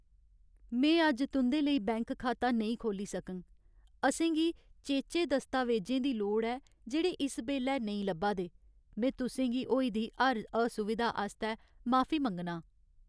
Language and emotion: Dogri, sad